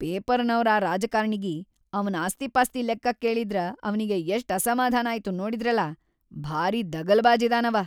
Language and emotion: Kannada, angry